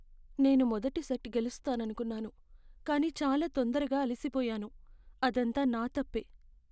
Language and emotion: Telugu, sad